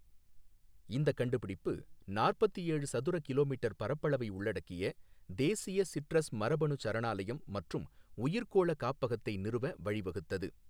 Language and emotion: Tamil, neutral